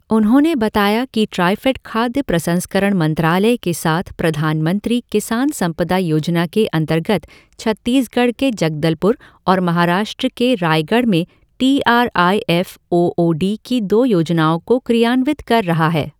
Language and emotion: Hindi, neutral